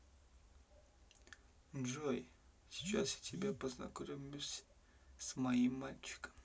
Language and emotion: Russian, neutral